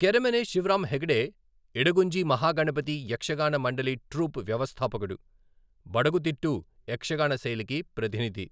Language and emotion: Telugu, neutral